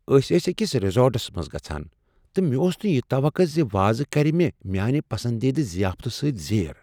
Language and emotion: Kashmiri, surprised